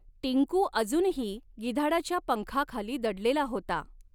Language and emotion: Marathi, neutral